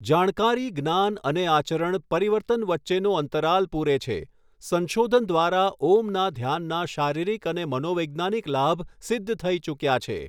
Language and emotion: Gujarati, neutral